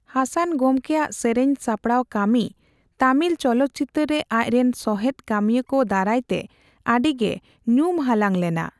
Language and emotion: Santali, neutral